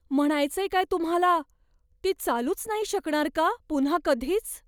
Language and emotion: Marathi, fearful